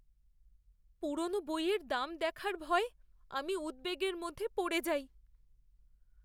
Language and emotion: Bengali, fearful